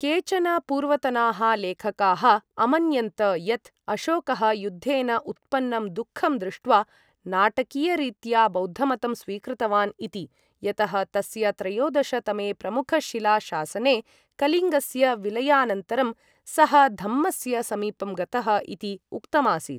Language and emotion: Sanskrit, neutral